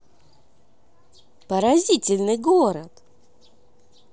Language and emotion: Russian, positive